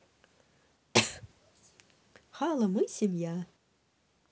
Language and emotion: Russian, positive